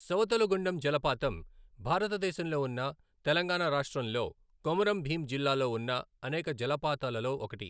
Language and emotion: Telugu, neutral